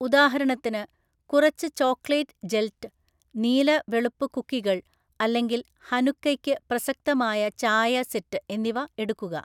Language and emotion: Malayalam, neutral